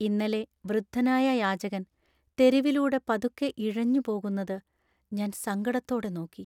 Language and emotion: Malayalam, sad